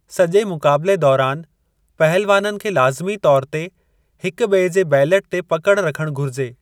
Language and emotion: Sindhi, neutral